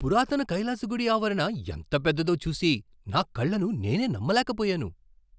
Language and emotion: Telugu, surprised